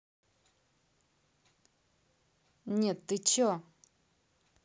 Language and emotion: Russian, neutral